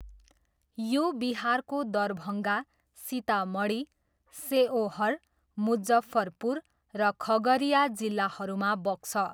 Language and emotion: Nepali, neutral